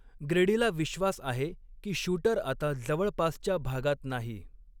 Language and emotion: Marathi, neutral